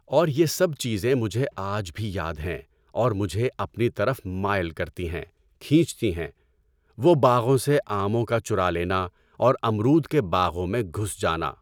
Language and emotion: Urdu, neutral